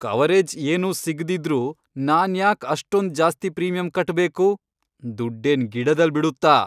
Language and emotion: Kannada, angry